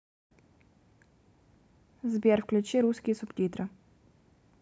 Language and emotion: Russian, neutral